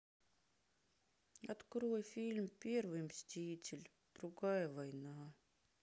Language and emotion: Russian, sad